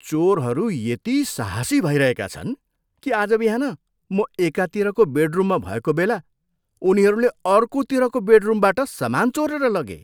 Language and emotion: Nepali, disgusted